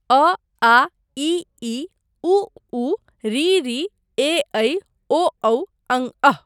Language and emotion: Maithili, neutral